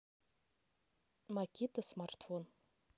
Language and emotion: Russian, neutral